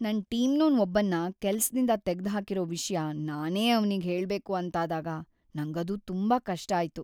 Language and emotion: Kannada, sad